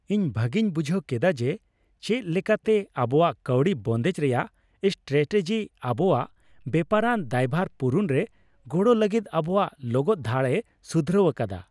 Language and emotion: Santali, happy